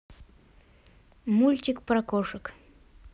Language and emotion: Russian, neutral